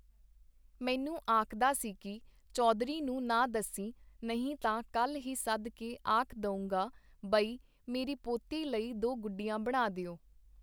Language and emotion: Punjabi, neutral